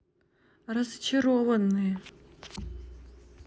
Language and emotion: Russian, neutral